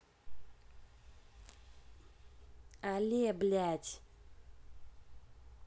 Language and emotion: Russian, angry